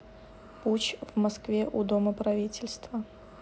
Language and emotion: Russian, neutral